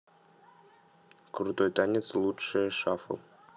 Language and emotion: Russian, neutral